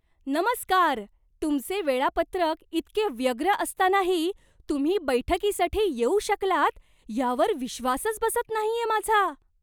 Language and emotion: Marathi, surprised